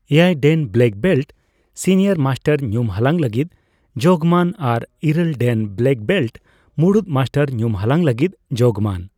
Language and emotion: Santali, neutral